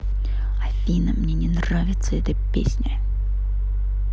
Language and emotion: Russian, angry